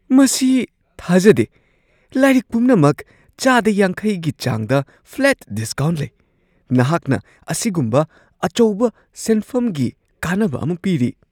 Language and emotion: Manipuri, surprised